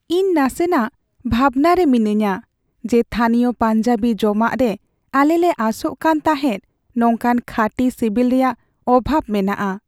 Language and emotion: Santali, sad